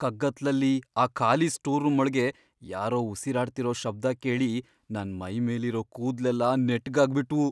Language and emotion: Kannada, fearful